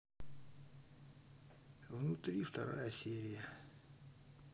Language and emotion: Russian, neutral